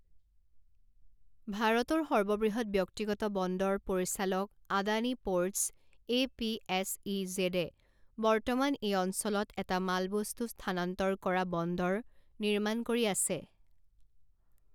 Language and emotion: Assamese, neutral